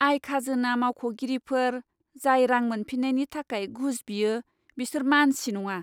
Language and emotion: Bodo, disgusted